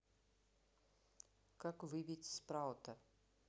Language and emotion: Russian, neutral